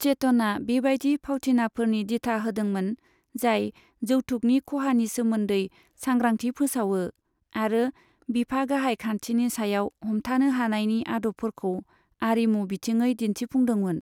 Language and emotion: Bodo, neutral